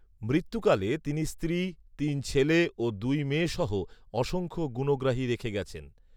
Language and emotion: Bengali, neutral